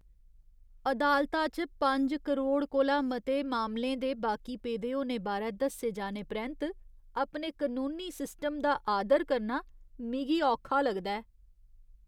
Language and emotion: Dogri, disgusted